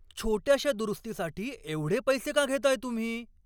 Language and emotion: Marathi, angry